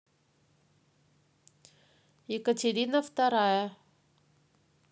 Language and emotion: Russian, neutral